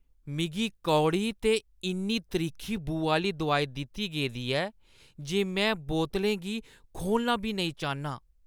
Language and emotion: Dogri, disgusted